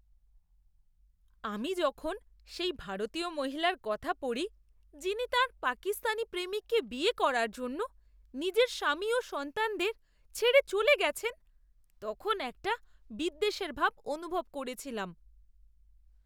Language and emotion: Bengali, disgusted